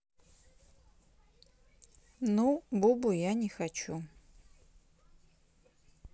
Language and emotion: Russian, neutral